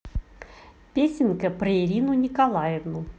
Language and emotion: Russian, positive